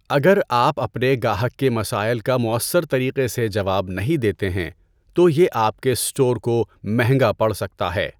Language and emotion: Urdu, neutral